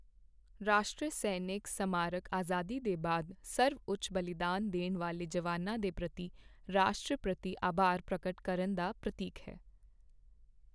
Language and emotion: Punjabi, neutral